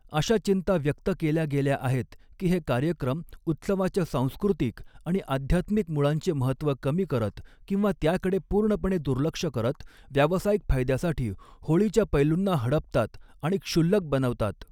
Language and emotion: Marathi, neutral